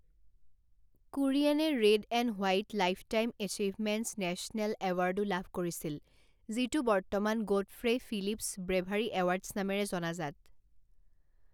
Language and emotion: Assamese, neutral